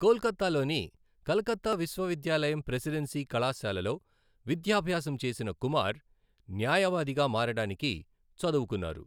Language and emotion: Telugu, neutral